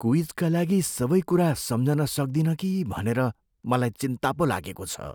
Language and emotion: Nepali, fearful